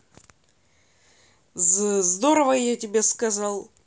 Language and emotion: Russian, neutral